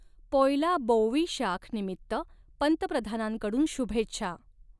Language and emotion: Marathi, neutral